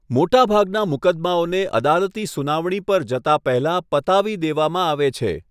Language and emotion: Gujarati, neutral